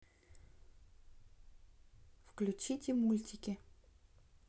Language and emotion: Russian, neutral